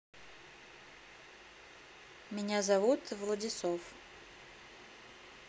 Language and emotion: Russian, neutral